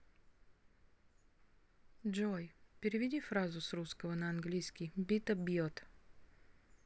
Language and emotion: Russian, neutral